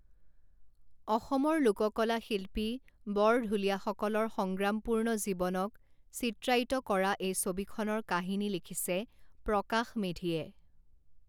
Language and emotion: Assamese, neutral